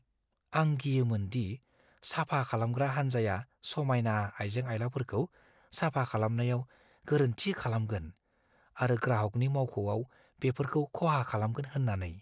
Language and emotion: Bodo, fearful